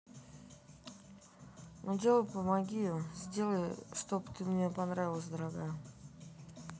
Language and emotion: Russian, sad